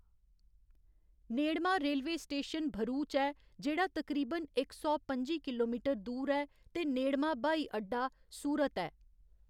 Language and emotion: Dogri, neutral